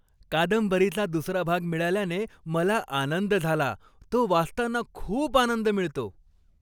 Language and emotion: Marathi, happy